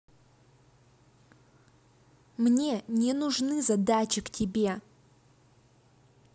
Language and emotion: Russian, angry